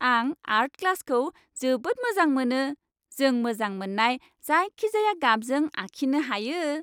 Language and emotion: Bodo, happy